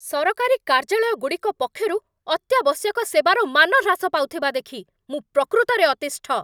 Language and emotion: Odia, angry